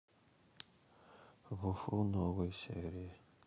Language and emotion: Russian, sad